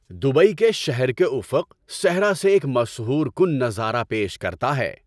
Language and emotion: Urdu, happy